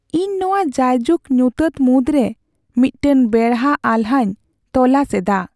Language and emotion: Santali, sad